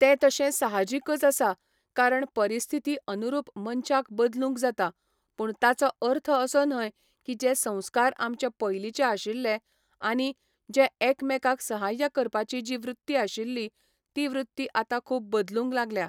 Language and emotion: Goan Konkani, neutral